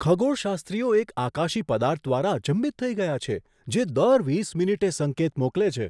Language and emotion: Gujarati, surprised